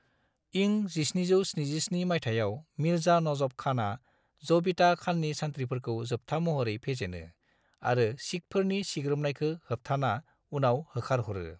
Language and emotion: Bodo, neutral